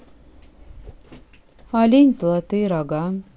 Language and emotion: Russian, neutral